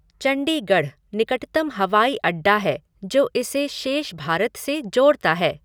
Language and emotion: Hindi, neutral